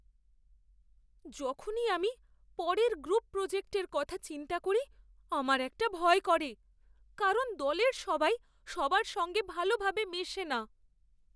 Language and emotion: Bengali, fearful